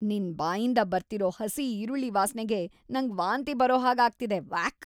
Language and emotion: Kannada, disgusted